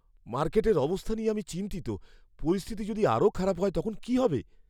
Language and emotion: Bengali, fearful